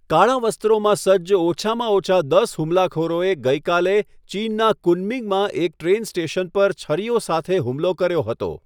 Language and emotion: Gujarati, neutral